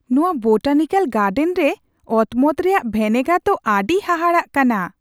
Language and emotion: Santali, surprised